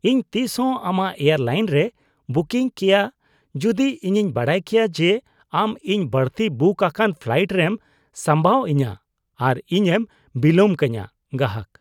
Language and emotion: Santali, disgusted